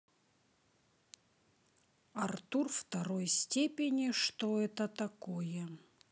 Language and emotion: Russian, neutral